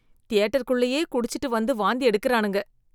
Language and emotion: Tamil, disgusted